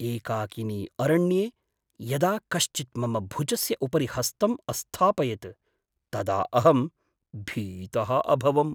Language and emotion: Sanskrit, surprised